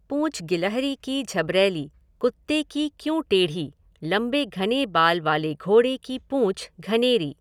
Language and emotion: Hindi, neutral